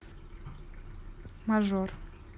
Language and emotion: Russian, neutral